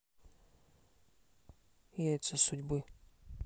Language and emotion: Russian, neutral